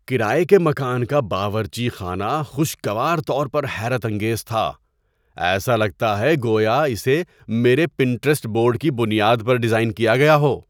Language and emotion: Urdu, surprised